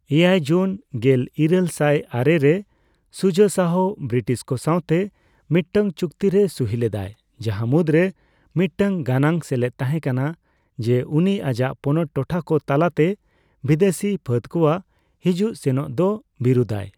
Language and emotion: Santali, neutral